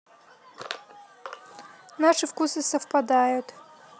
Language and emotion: Russian, neutral